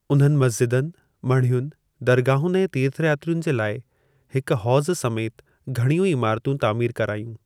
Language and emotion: Sindhi, neutral